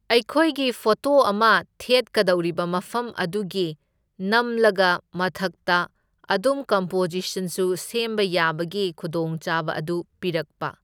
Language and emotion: Manipuri, neutral